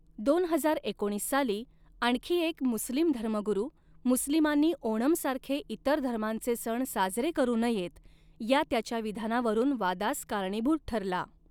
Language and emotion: Marathi, neutral